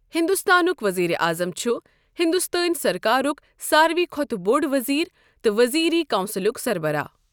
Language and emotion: Kashmiri, neutral